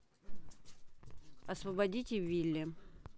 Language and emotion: Russian, neutral